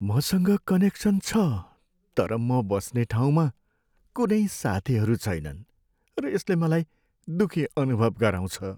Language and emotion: Nepali, sad